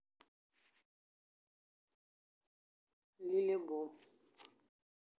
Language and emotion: Russian, neutral